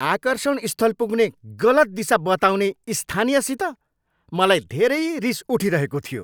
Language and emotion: Nepali, angry